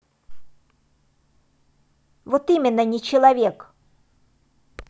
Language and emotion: Russian, angry